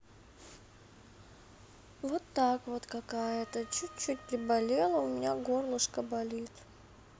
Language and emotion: Russian, sad